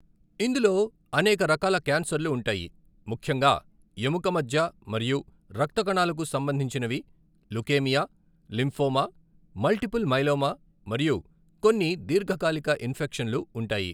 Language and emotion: Telugu, neutral